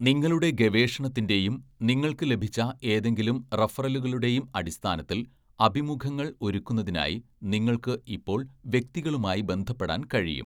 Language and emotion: Malayalam, neutral